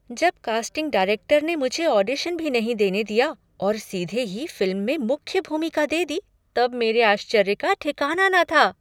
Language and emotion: Hindi, surprised